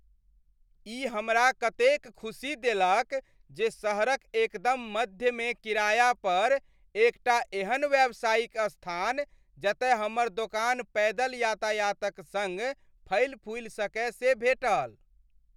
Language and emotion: Maithili, happy